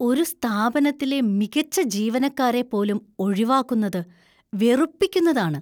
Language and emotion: Malayalam, disgusted